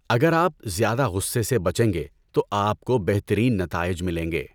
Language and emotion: Urdu, neutral